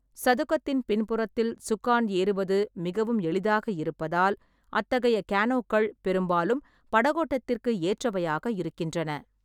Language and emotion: Tamil, neutral